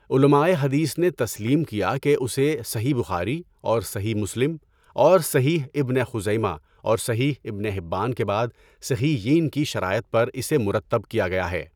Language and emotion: Urdu, neutral